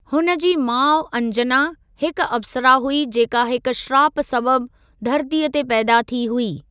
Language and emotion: Sindhi, neutral